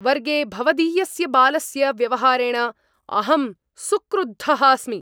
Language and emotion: Sanskrit, angry